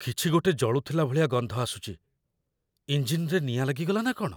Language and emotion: Odia, fearful